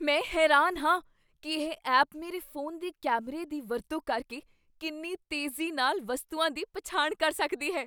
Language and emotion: Punjabi, surprised